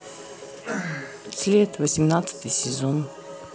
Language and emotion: Russian, neutral